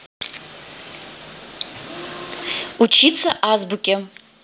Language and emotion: Russian, neutral